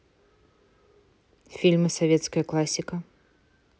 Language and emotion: Russian, neutral